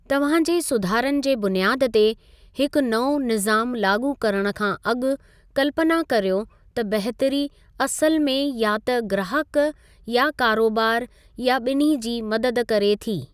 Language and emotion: Sindhi, neutral